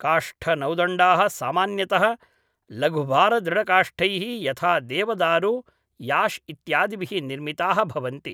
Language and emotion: Sanskrit, neutral